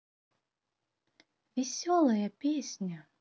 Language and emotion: Russian, positive